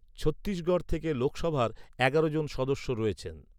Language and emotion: Bengali, neutral